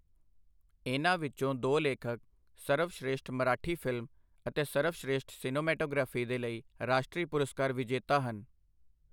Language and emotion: Punjabi, neutral